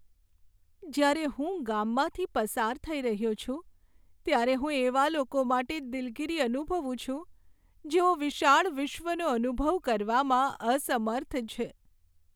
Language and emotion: Gujarati, sad